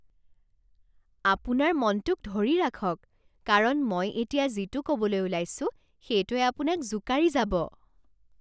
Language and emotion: Assamese, surprised